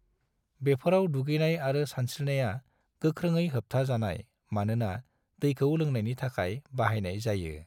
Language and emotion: Bodo, neutral